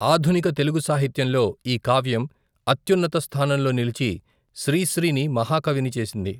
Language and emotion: Telugu, neutral